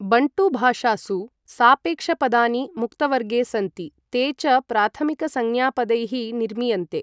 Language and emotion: Sanskrit, neutral